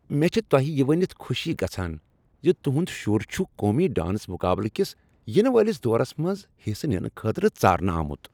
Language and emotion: Kashmiri, happy